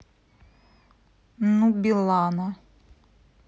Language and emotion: Russian, neutral